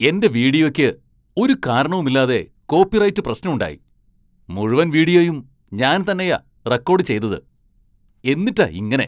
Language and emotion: Malayalam, angry